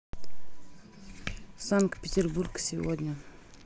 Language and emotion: Russian, neutral